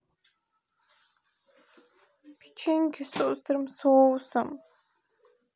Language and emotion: Russian, sad